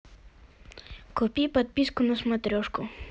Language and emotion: Russian, neutral